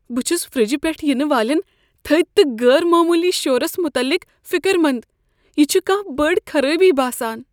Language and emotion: Kashmiri, fearful